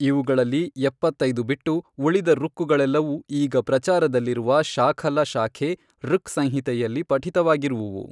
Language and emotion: Kannada, neutral